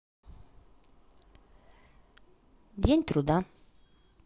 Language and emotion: Russian, positive